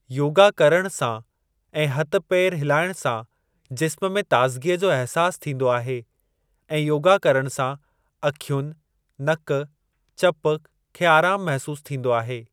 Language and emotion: Sindhi, neutral